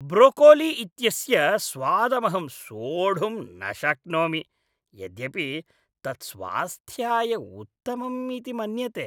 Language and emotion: Sanskrit, disgusted